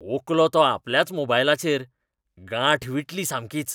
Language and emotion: Goan Konkani, disgusted